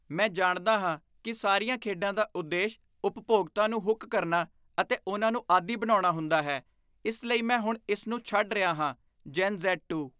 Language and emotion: Punjabi, disgusted